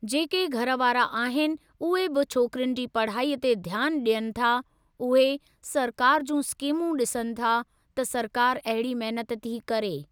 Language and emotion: Sindhi, neutral